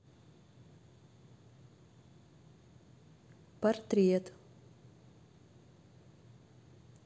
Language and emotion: Russian, neutral